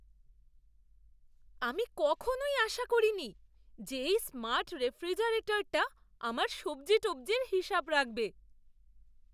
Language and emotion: Bengali, surprised